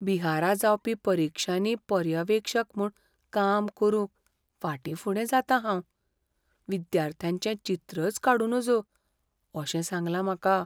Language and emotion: Goan Konkani, fearful